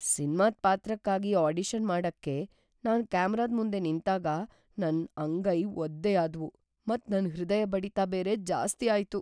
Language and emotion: Kannada, fearful